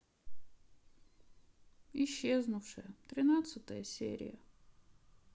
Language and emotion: Russian, sad